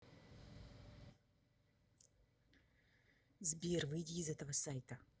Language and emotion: Russian, angry